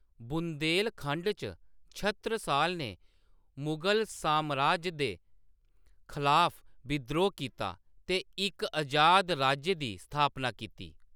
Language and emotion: Dogri, neutral